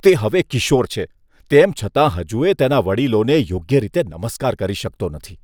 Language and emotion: Gujarati, disgusted